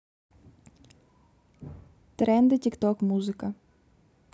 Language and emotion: Russian, neutral